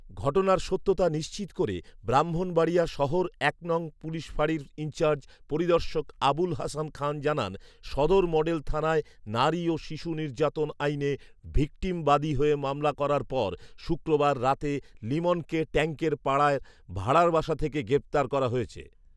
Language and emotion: Bengali, neutral